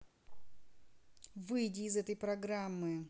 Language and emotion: Russian, angry